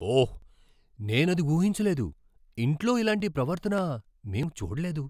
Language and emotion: Telugu, surprised